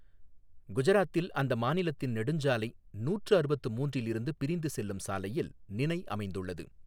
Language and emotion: Tamil, neutral